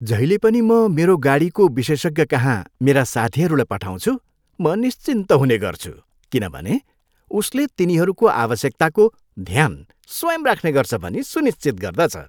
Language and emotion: Nepali, happy